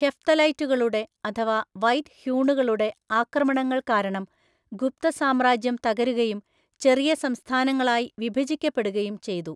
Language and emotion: Malayalam, neutral